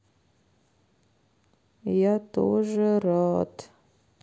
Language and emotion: Russian, sad